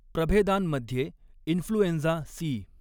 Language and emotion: Marathi, neutral